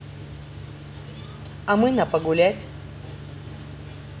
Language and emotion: Russian, positive